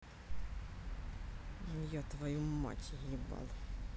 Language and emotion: Russian, angry